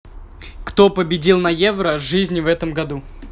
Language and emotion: Russian, neutral